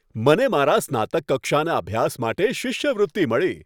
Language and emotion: Gujarati, happy